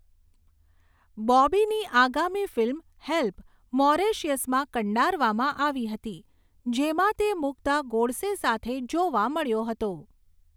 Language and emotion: Gujarati, neutral